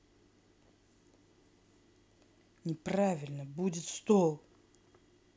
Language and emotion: Russian, angry